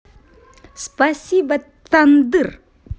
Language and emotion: Russian, positive